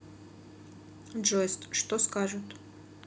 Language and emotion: Russian, neutral